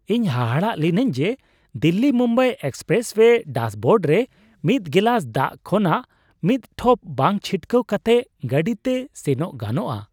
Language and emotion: Santali, surprised